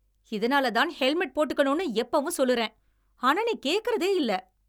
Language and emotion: Tamil, angry